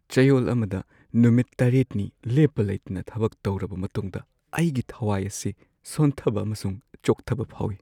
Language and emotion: Manipuri, sad